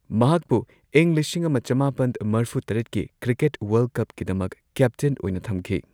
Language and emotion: Manipuri, neutral